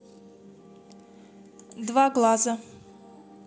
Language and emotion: Russian, neutral